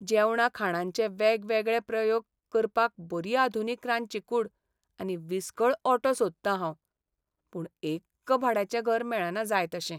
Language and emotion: Goan Konkani, sad